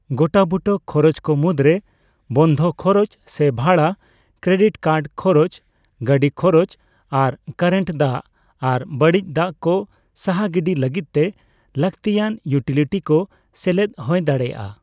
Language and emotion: Santali, neutral